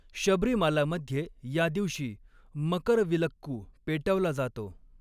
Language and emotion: Marathi, neutral